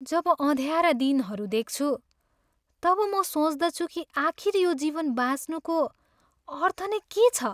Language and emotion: Nepali, sad